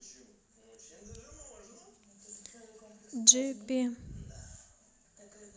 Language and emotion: Russian, neutral